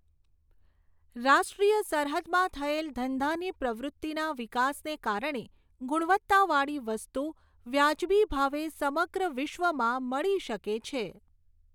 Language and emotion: Gujarati, neutral